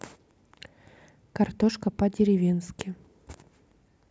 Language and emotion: Russian, neutral